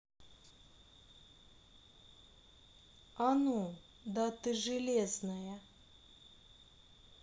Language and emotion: Russian, neutral